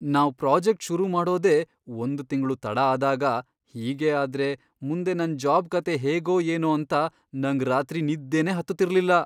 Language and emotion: Kannada, fearful